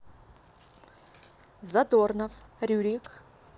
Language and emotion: Russian, neutral